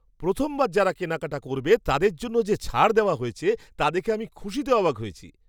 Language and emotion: Bengali, surprised